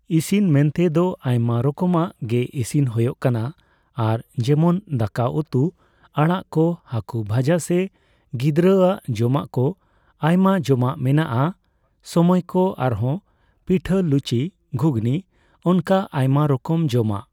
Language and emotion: Santali, neutral